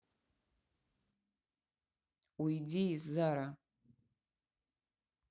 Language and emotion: Russian, angry